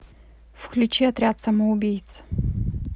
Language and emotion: Russian, neutral